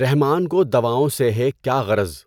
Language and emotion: Urdu, neutral